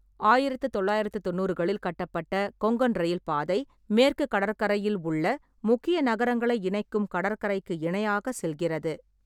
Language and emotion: Tamil, neutral